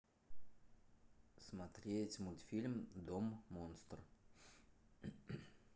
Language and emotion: Russian, neutral